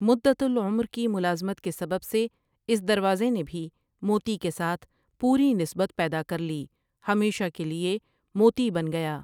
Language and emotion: Urdu, neutral